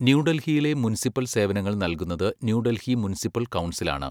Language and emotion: Malayalam, neutral